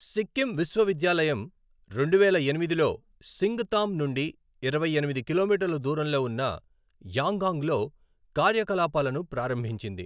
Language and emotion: Telugu, neutral